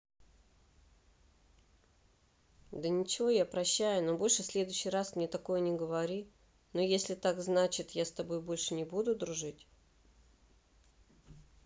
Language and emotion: Russian, neutral